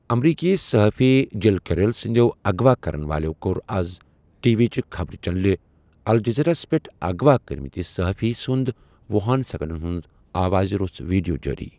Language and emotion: Kashmiri, neutral